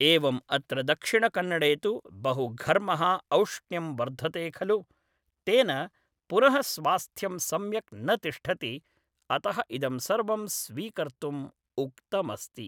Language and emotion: Sanskrit, neutral